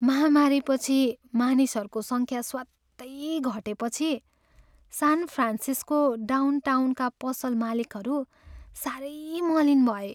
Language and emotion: Nepali, sad